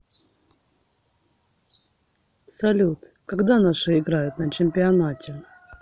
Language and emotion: Russian, neutral